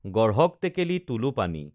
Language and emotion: Assamese, neutral